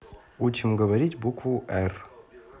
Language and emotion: Russian, neutral